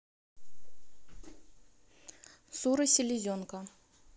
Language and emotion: Russian, neutral